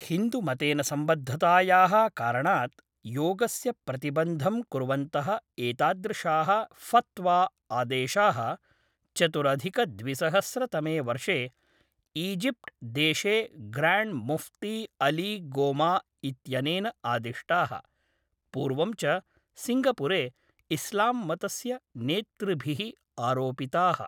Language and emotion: Sanskrit, neutral